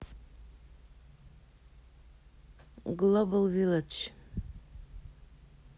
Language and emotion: Russian, neutral